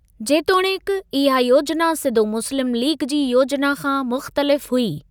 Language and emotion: Sindhi, neutral